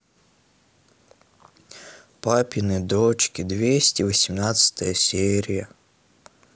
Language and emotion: Russian, sad